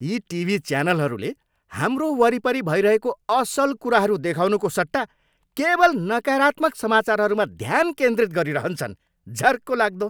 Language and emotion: Nepali, angry